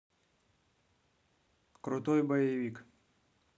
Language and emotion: Russian, neutral